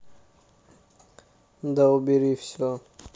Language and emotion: Russian, neutral